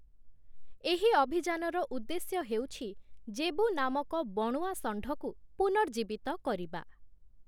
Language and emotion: Odia, neutral